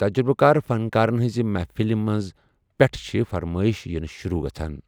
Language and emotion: Kashmiri, neutral